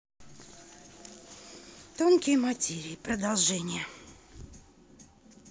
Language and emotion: Russian, neutral